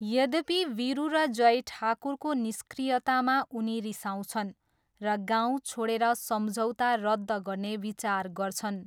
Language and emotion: Nepali, neutral